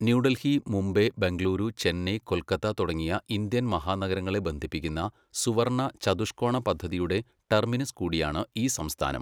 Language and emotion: Malayalam, neutral